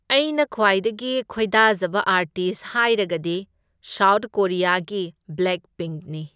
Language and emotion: Manipuri, neutral